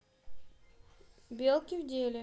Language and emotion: Russian, neutral